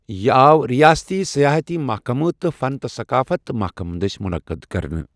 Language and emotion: Kashmiri, neutral